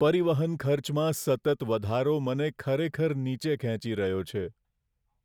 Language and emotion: Gujarati, sad